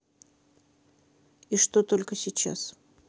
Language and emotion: Russian, neutral